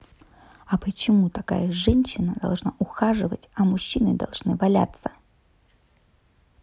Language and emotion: Russian, angry